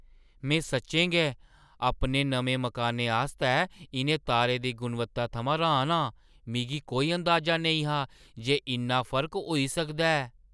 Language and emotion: Dogri, surprised